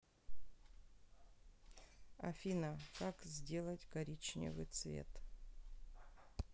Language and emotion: Russian, neutral